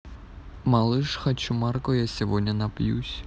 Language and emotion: Russian, neutral